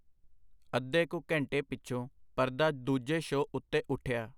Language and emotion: Punjabi, neutral